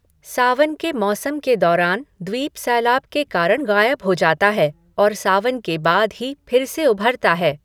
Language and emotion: Hindi, neutral